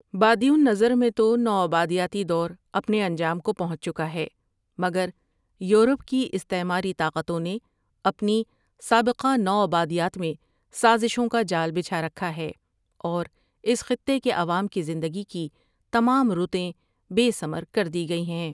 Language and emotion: Urdu, neutral